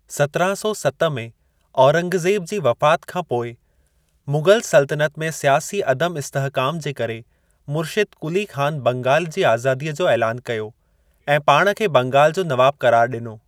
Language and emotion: Sindhi, neutral